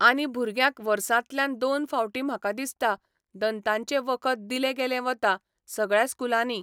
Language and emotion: Goan Konkani, neutral